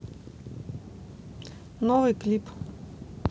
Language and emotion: Russian, neutral